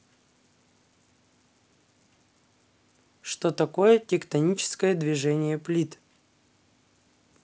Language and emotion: Russian, neutral